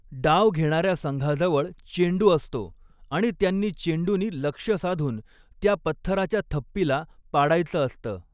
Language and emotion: Marathi, neutral